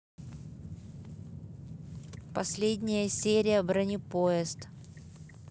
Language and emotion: Russian, neutral